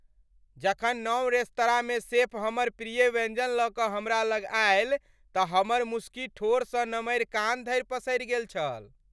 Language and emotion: Maithili, happy